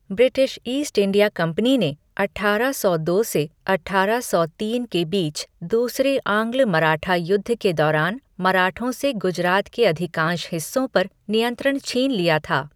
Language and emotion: Hindi, neutral